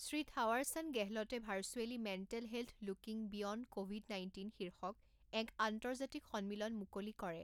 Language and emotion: Assamese, neutral